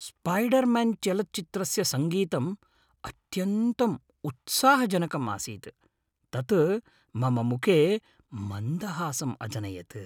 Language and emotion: Sanskrit, happy